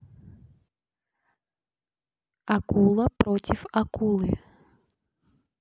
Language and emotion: Russian, neutral